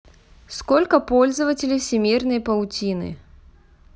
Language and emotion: Russian, neutral